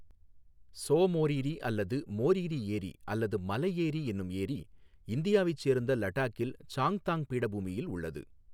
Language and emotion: Tamil, neutral